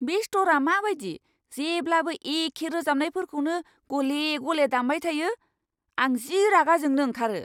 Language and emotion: Bodo, angry